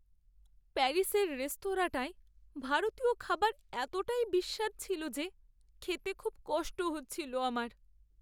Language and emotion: Bengali, sad